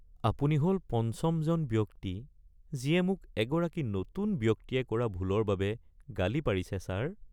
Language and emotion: Assamese, sad